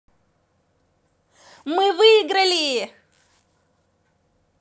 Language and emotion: Russian, positive